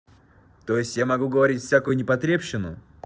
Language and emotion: Russian, angry